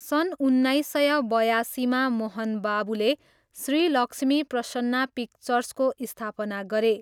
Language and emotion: Nepali, neutral